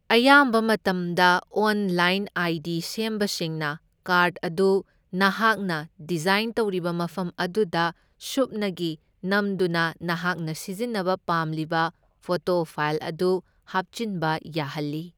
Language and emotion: Manipuri, neutral